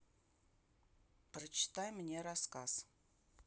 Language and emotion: Russian, neutral